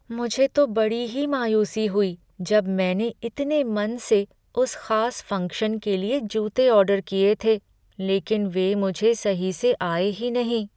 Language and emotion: Hindi, sad